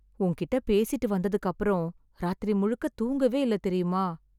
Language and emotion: Tamil, sad